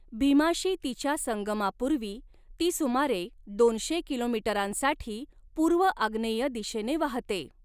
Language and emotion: Marathi, neutral